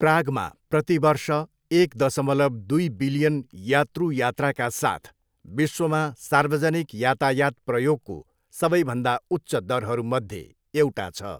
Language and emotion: Nepali, neutral